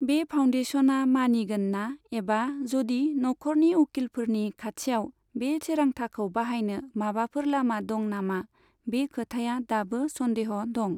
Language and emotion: Bodo, neutral